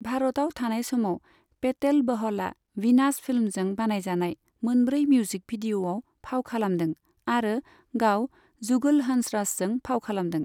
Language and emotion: Bodo, neutral